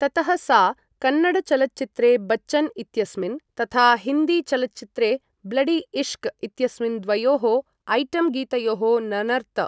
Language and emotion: Sanskrit, neutral